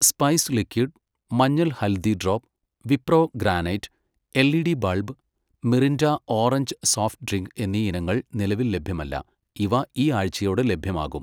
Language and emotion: Malayalam, neutral